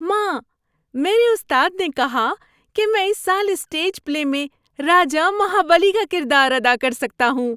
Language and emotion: Urdu, happy